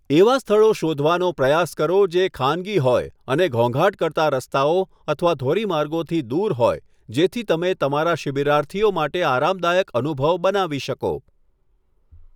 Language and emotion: Gujarati, neutral